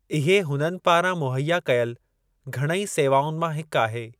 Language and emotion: Sindhi, neutral